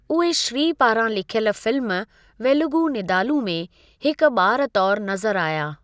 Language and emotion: Sindhi, neutral